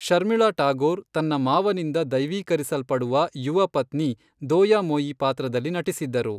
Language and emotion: Kannada, neutral